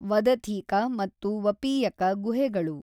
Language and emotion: Kannada, neutral